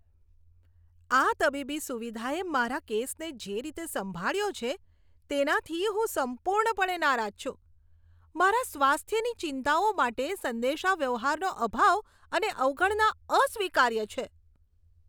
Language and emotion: Gujarati, disgusted